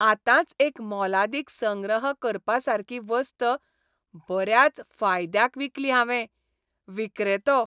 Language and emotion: Goan Konkani, happy